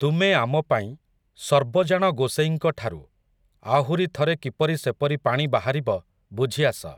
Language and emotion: Odia, neutral